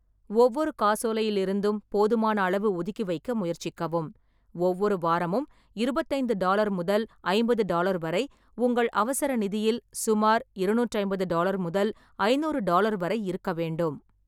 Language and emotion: Tamil, neutral